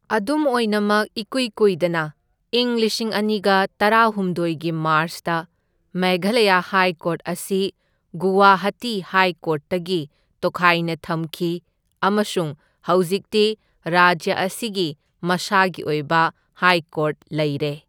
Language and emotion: Manipuri, neutral